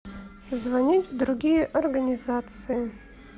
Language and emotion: Russian, neutral